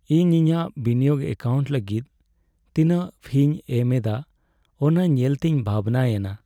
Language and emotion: Santali, sad